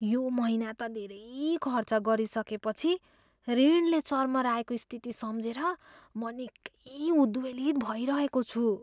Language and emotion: Nepali, fearful